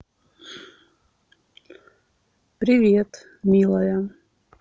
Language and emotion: Russian, neutral